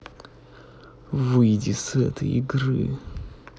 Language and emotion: Russian, angry